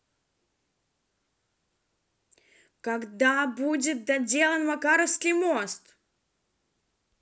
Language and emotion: Russian, angry